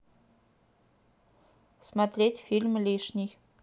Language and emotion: Russian, neutral